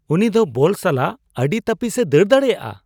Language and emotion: Santali, surprised